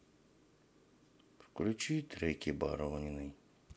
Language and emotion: Russian, sad